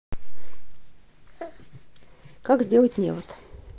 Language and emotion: Russian, neutral